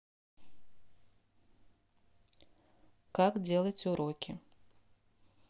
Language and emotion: Russian, neutral